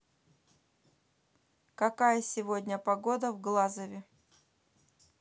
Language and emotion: Russian, neutral